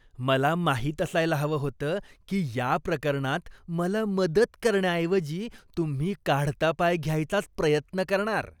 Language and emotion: Marathi, disgusted